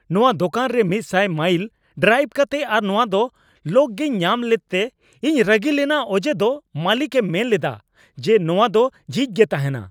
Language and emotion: Santali, angry